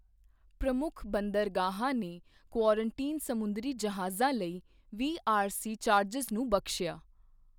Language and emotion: Punjabi, neutral